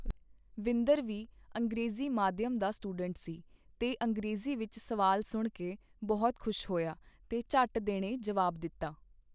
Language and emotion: Punjabi, neutral